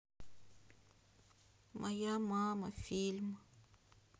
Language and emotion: Russian, sad